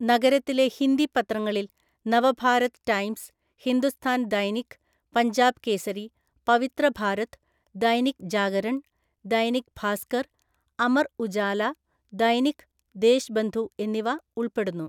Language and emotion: Malayalam, neutral